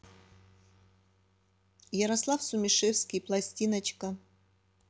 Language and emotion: Russian, neutral